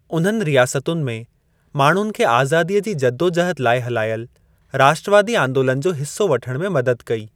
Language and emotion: Sindhi, neutral